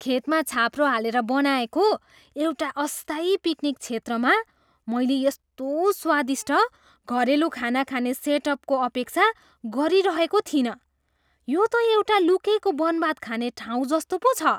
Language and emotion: Nepali, surprised